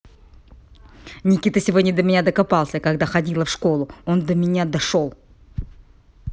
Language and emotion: Russian, angry